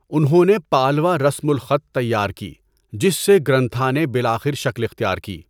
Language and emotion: Urdu, neutral